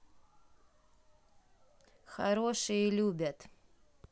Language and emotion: Russian, neutral